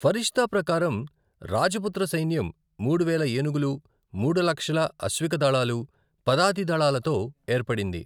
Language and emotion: Telugu, neutral